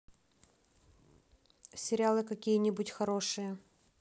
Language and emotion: Russian, neutral